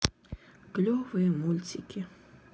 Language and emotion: Russian, sad